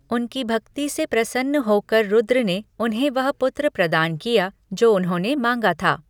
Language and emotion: Hindi, neutral